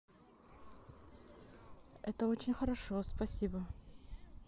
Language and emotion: Russian, neutral